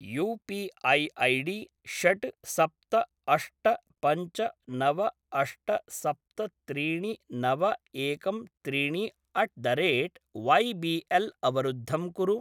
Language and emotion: Sanskrit, neutral